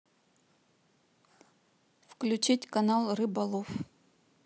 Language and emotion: Russian, neutral